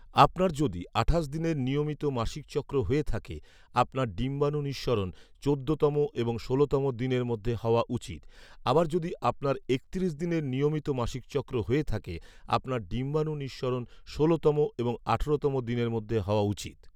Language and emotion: Bengali, neutral